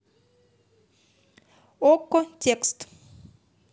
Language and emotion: Russian, neutral